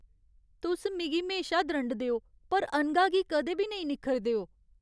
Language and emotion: Dogri, sad